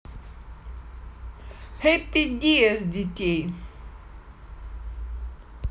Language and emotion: Russian, positive